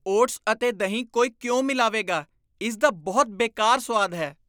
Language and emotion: Punjabi, disgusted